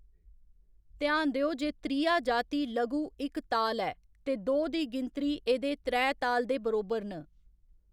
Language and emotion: Dogri, neutral